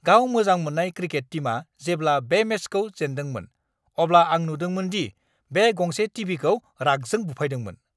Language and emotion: Bodo, angry